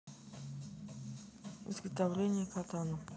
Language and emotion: Russian, neutral